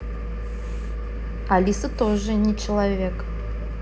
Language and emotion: Russian, neutral